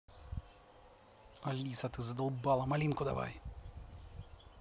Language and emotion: Russian, angry